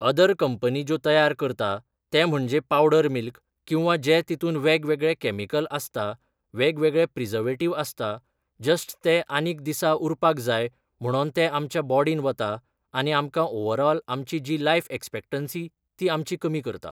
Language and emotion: Goan Konkani, neutral